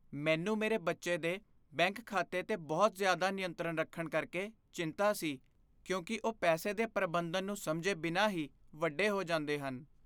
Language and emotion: Punjabi, fearful